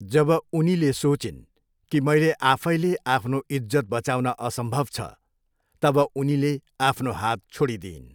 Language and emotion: Nepali, neutral